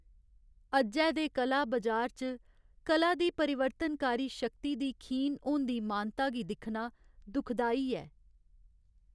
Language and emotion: Dogri, sad